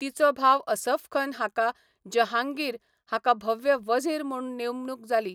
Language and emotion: Goan Konkani, neutral